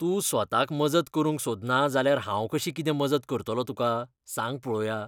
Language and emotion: Goan Konkani, disgusted